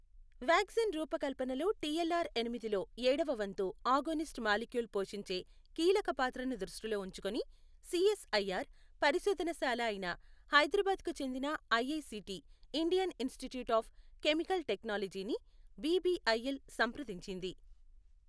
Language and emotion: Telugu, neutral